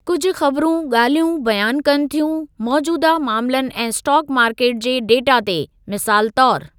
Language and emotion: Sindhi, neutral